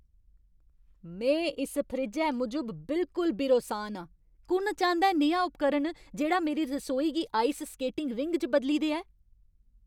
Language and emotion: Dogri, angry